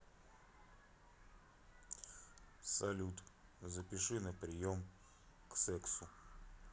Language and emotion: Russian, neutral